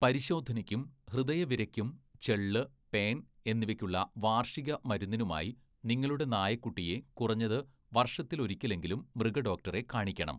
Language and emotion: Malayalam, neutral